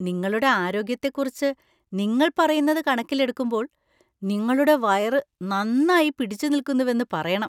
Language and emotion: Malayalam, surprised